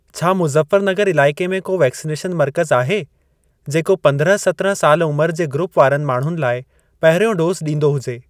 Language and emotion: Sindhi, neutral